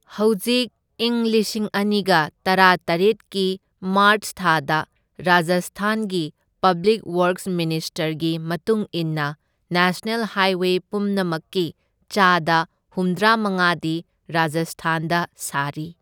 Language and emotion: Manipuri, neutral